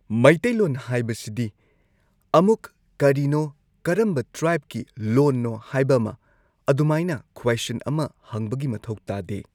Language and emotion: Manipuri, neutral